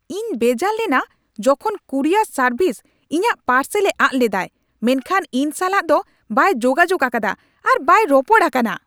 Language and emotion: Santali, angry